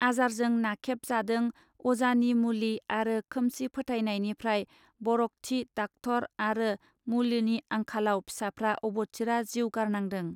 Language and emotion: Bodo, neutral